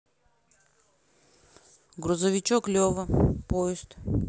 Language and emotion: Russian, neutral